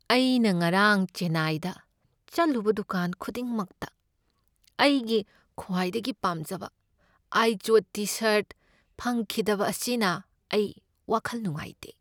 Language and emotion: Manipuri, sad